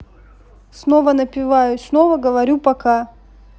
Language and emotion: Russian, neutral